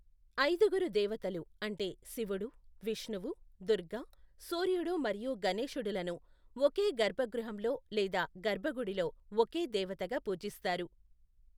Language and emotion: Telugu, neutral